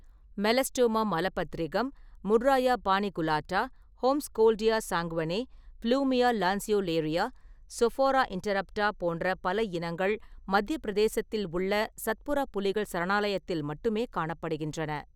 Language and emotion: Tamil, neutral